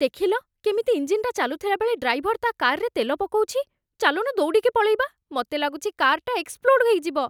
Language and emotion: Odia, fearful